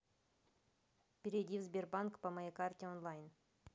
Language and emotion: Russian, neutral